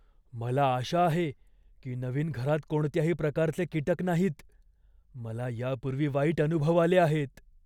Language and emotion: Marathi, fearful